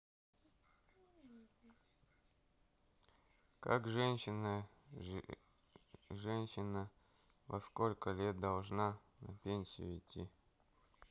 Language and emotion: Russian, neutral